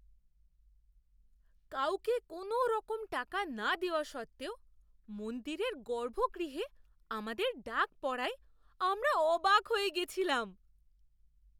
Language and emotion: Bengali, surprised